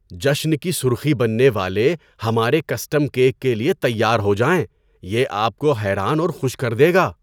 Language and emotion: Urdu, surprised